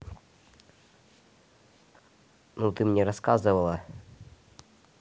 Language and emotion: Russian, neutral